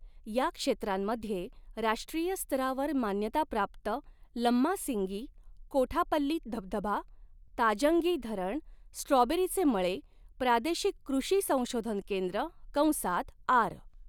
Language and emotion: Marathi, neutral